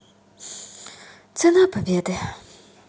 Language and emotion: Russian, sad